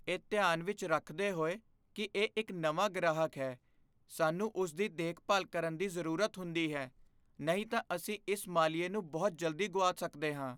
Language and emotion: Punjabi, fearful